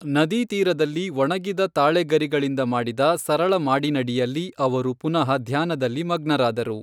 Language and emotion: Kannada, neutral